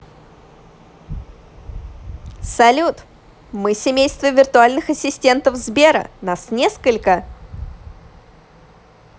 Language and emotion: Russian, positive